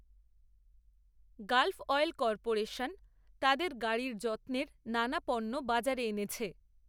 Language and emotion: Bengali, neutral